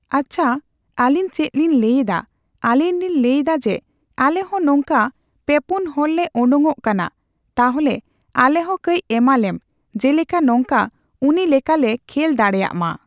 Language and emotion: Santali, neutral